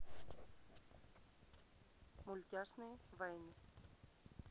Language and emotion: Russian, neutral